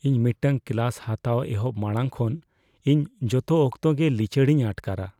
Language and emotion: Santali, fearful